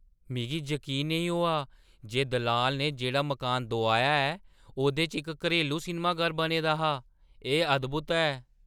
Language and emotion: Dogri, surprised